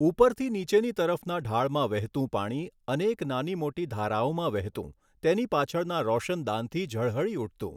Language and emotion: Gujarati, neutral